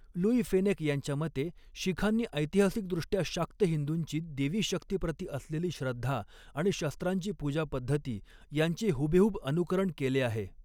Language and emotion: Marathi, neutral